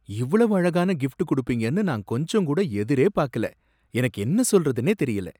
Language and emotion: Tamil, surprised